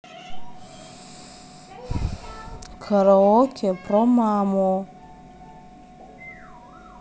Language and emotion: Russian, angry